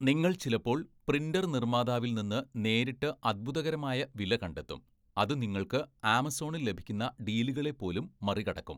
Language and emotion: Malayalam, neutral